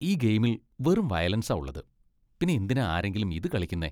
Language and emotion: Malayalam, disgusted